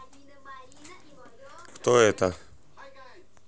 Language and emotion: Russian, neutral